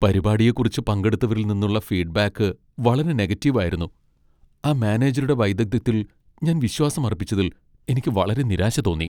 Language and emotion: Malayalam, sad